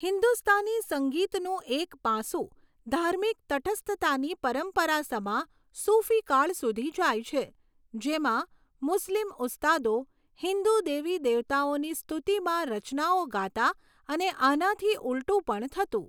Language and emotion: Gujarati, neutral